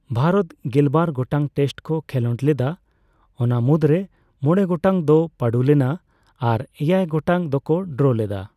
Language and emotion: Santali, neutral